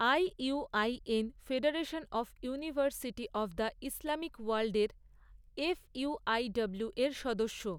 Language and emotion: Bengali, neutral